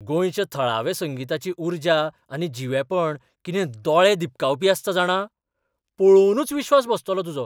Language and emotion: Goan Konkani, surprised